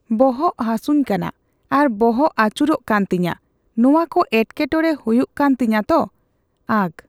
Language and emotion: Santali, neutral